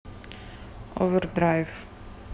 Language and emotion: Russian, neutral